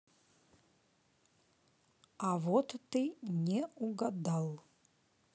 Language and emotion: Russian, neutral